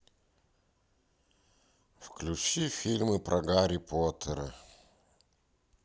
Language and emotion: Russian, neutral